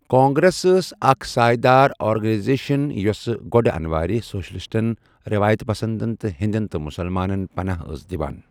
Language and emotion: Kashmiri, neutral